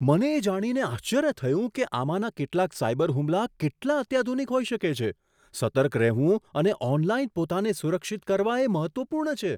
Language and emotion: Gujarati, surprised